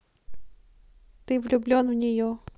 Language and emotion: Russian, neutral